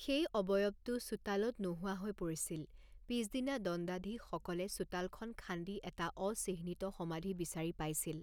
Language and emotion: Assamese, neutral